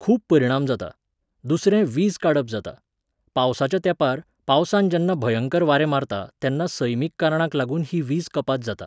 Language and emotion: Goan Konkani, neutral